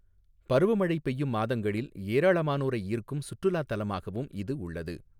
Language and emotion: Tamil, neutral